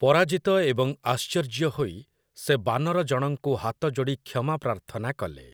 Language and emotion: Odia, neutral